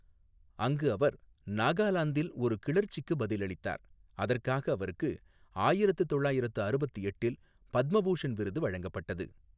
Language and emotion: Tamil, neutral